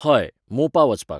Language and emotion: Goan Konkani, neutral